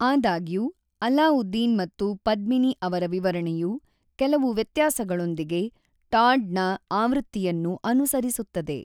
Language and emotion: Kannada, neutral